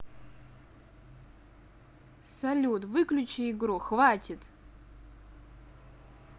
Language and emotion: Russian, neutral